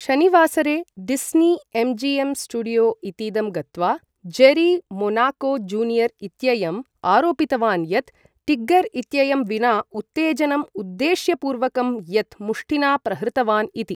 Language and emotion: Sanskrit, neutral